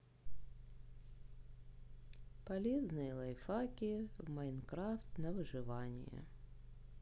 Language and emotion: Russian, sad